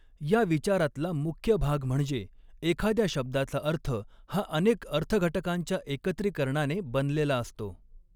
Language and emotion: Marathi, neutral